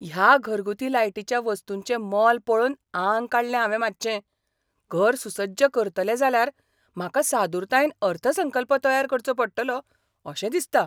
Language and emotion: Goan Konkani, surprised